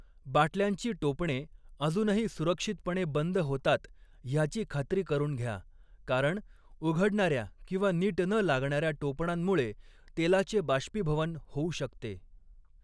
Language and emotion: Marathi, neutral